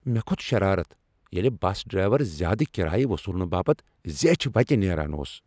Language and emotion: Kashmiri, angry